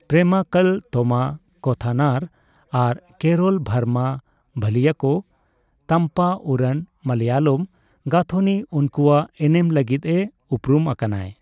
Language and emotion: Santali, neutral